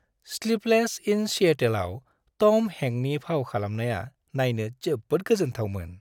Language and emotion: Bodo, happy